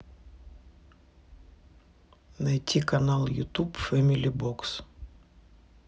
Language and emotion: Russian, neutral